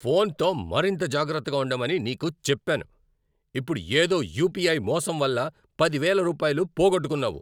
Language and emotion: Telugu, angry